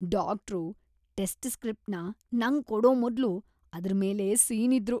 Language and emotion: Kannada, disgusted